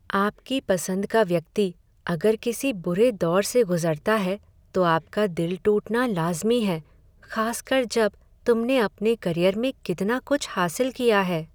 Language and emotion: Hindi, sad